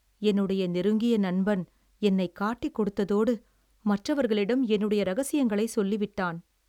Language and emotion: Tamil, sad